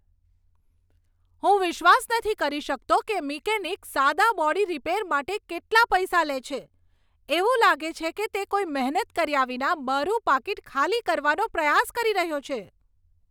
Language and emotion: Gujarati, angry